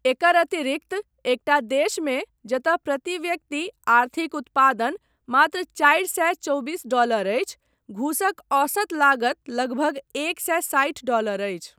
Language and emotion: Maithili, neutral